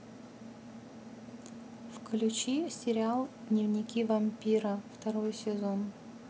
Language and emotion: Russian, neutral